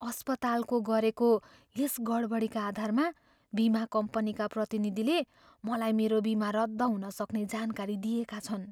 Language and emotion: Nepali, fearful